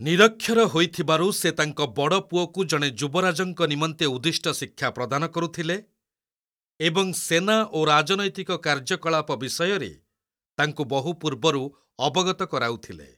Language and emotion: Odia, neutral